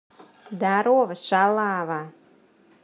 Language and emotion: Russian, positive